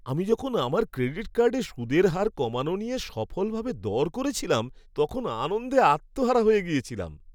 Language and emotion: Bengali, happy